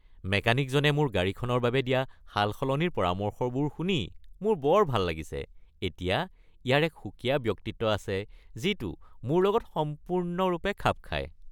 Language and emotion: Assamese, happy